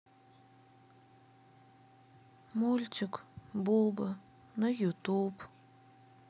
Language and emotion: Russian, sad